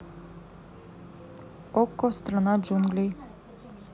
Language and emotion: Russian, neutral